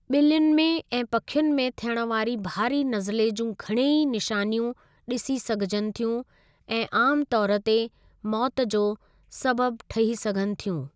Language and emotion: Sindhi, neutral